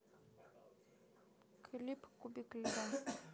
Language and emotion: Russian, neutral